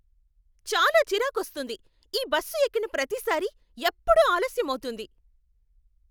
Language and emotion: Telugu, angry